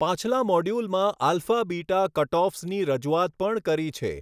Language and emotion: Gujarati, neutral